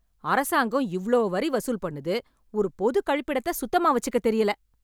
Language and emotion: Tamil, angry